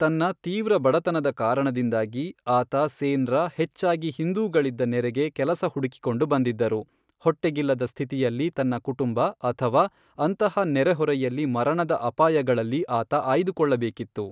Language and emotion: Kannada, neutral